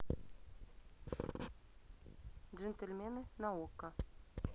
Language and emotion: Russian, neutral